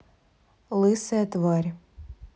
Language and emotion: Russian, neutral